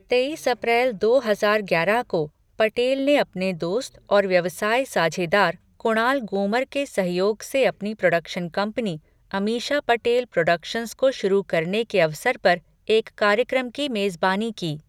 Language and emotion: Hindi, neutral